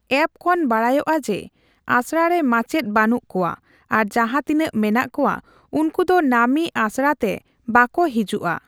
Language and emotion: Santali, neutral